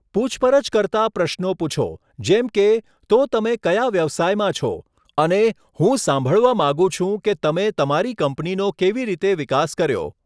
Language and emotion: Gujarati, neutral